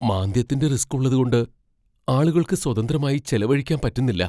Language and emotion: Malayalam, fearful